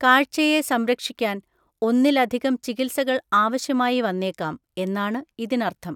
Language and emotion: Malayalam, neutral